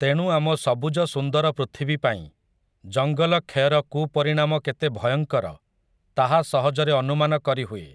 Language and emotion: Odia, neutral